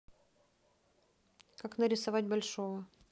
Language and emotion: Russian, neutral